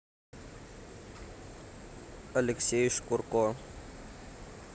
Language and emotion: Russian, neutral